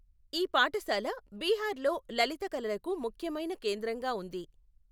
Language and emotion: Telugu, neutral